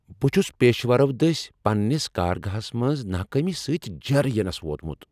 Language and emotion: Kashmiri, angry